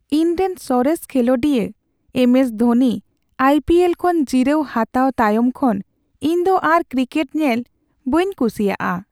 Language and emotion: Santali, sad